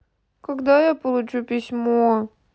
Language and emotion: Russian, sad